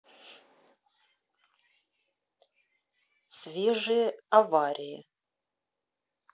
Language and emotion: Russian, neutral